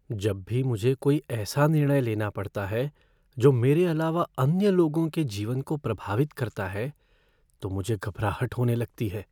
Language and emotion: Hindi, fearful